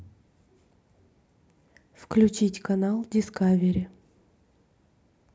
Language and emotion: Russian, neutral